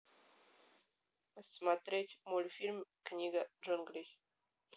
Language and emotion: Russian, neutral